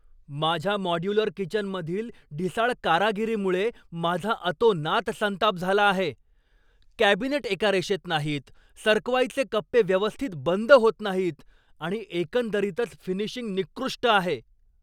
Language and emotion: Marathi, angry